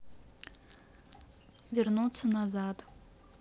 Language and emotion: Russian, neutral